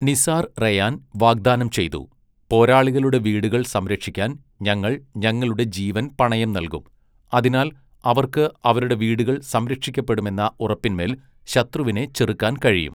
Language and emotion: Malayalam, neutral